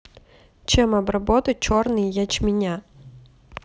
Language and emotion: Russian, neutral